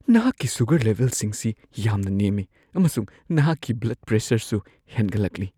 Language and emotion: Manipuri, fearful